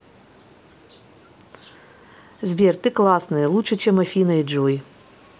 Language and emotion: Russian, positive